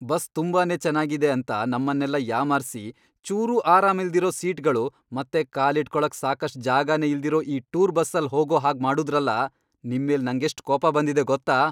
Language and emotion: Kannada, angry